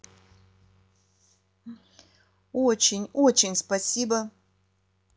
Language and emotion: Russian, positive